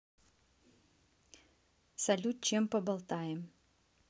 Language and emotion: Russian, neutral